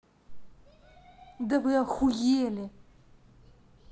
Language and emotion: Russian, angry